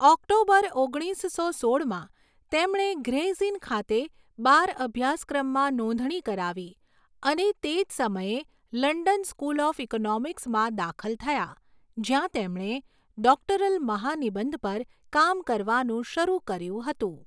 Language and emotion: Gujarati, neutral